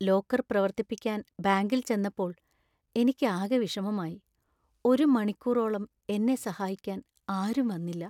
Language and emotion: Malayalam, sad